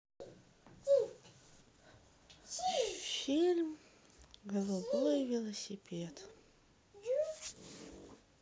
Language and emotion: Russian, sad